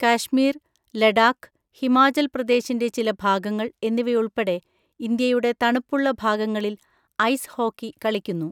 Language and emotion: Malayalam, neutral